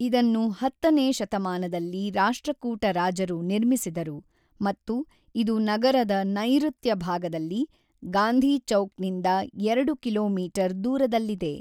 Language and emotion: Kannada, neutral